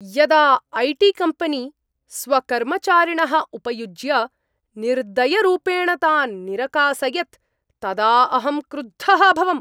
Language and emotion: Sanskrit, angry